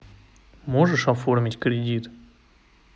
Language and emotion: Russian, neutral